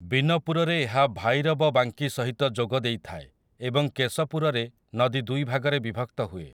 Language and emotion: Odia, neutral